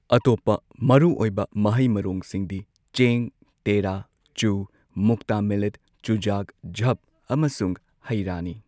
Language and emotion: Manipuri, neutral